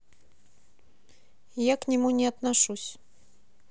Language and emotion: Russian, neutral